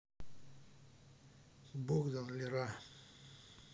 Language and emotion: Russian, neutral